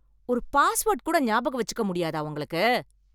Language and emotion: Tamil, angry